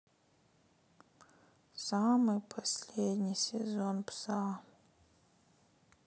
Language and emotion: Russian, sad